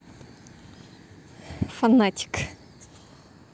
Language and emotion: Russian, positive